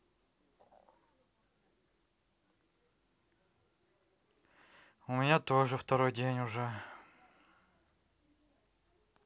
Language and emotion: Russian, sad